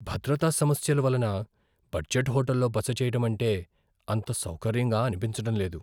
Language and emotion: Telugu, fearful